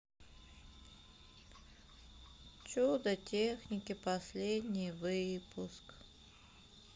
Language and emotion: Russian, sad